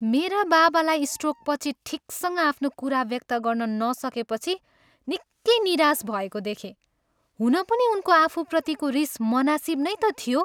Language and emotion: Nepali, angry